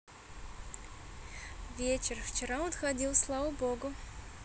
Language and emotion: Russian, positive